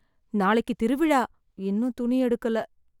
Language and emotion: Tamil, sad